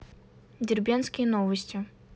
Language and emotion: Russian, neutral